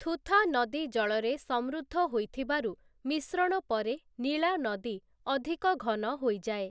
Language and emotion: Odia, neutral